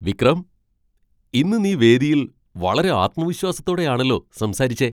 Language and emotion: Malayalam, surprised